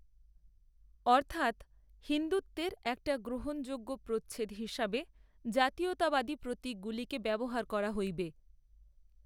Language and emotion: Bengali, neutral